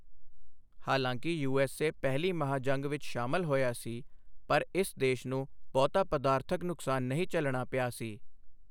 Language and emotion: Punjabi, neutral